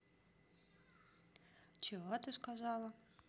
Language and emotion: Russian, neutral